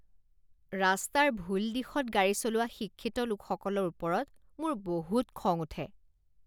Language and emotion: Assamese, disgusted